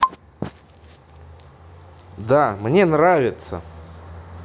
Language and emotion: Russian, positive